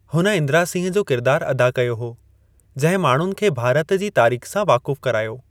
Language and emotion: Sindhi, neutral